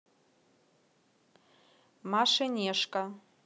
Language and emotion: Russian, neutral